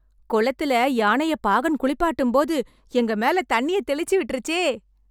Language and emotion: Tamil, happy